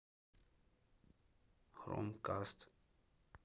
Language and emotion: Russian, neutral